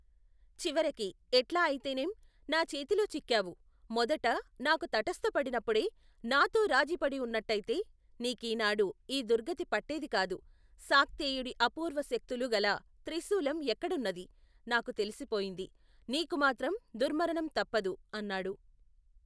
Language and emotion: Telugu, neutral